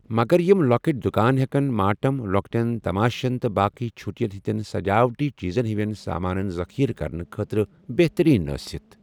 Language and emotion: Kashmiri, neutral